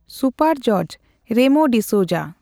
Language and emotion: Santali, neutral